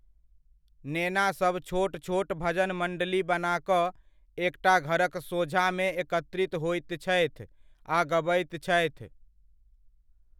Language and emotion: Maithili, neutral